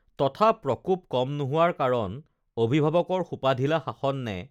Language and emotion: Assamese, neutral